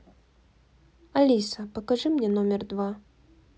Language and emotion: Russian, neutral